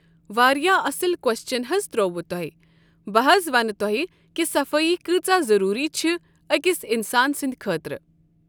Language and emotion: Kashmiri, neutral